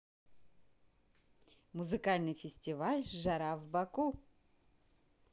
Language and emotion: Russian, positive